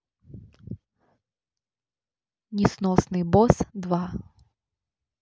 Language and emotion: Russian, neutral